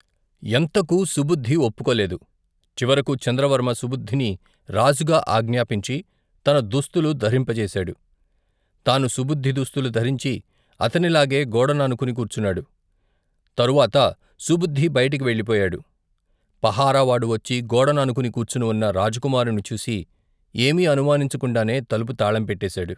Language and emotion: Telugu, neutral